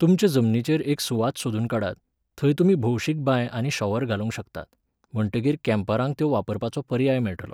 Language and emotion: Goan Konkani, neutral